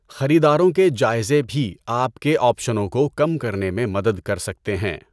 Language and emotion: Urdu, neutral